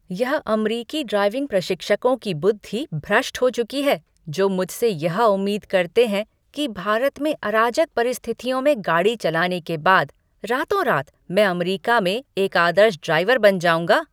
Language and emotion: Hindi, angry